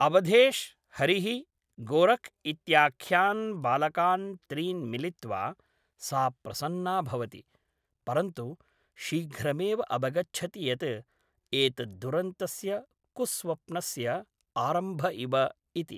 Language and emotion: Sanskrit, neutral